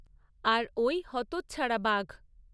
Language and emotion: Bengali, neutral